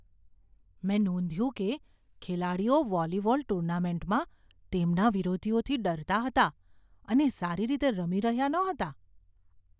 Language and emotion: Gujarati, fearful